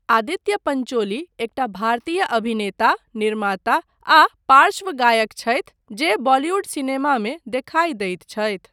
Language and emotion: Maithili, neutral